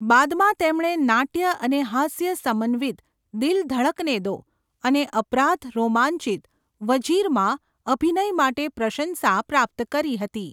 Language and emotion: Gujarati, neutral